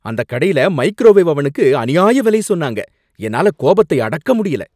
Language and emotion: Tamil, angry